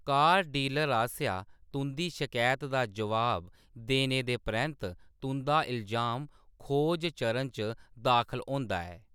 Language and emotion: Dogri, neutral